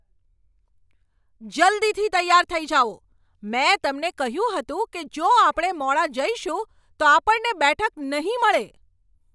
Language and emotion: Gujarati, angry